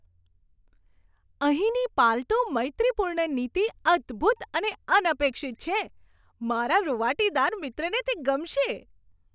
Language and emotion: Gujarati, surprised